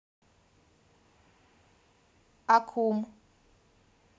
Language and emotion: Russian, neutral